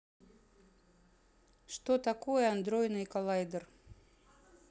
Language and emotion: Russian, neutral